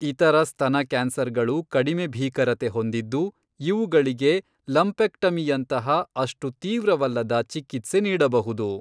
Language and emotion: Kannada, neutral